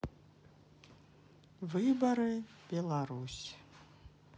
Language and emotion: Russian, sad